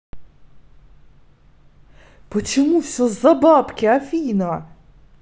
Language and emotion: Russian, angry